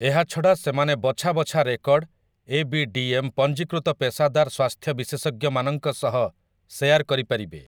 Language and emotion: Odia, neutral